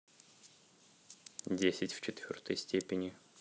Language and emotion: Russian, neutral